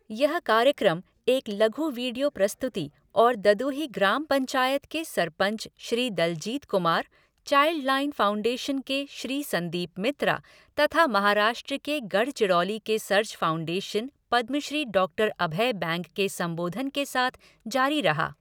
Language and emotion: Hindi, neutral